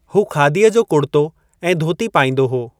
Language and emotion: Sindhi, neutral